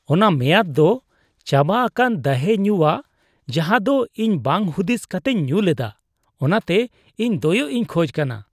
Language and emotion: Santali, disgusted